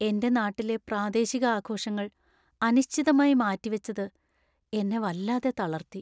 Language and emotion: Malayalam, sad